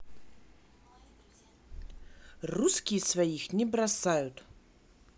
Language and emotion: Russian, positive